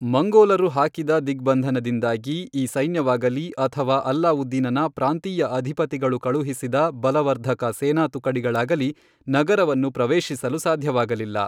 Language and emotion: Kannada, neutral